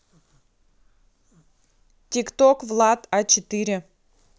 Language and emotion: Russian, neutral